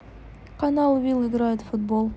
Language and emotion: Russian, neutral